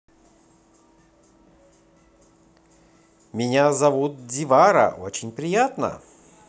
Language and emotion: Russian, positive